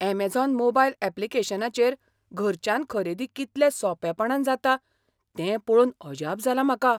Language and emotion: Goan Konkani, surprised